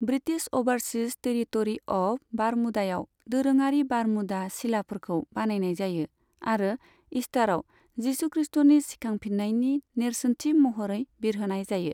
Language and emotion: Bodo, neutral